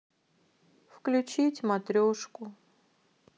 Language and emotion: Russian, sad